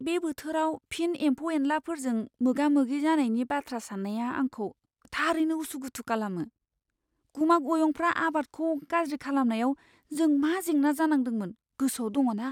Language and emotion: Bodo, fearful